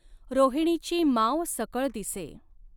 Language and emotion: Marathi, neutral